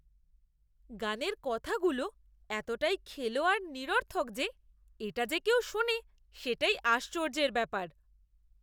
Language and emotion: Bengali, disgusted